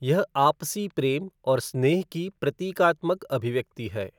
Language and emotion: Hindi, neutral